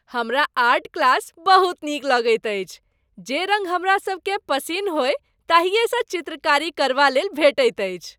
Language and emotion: Maithili, happy